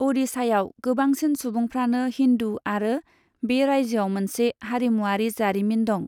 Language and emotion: Bodo, neutral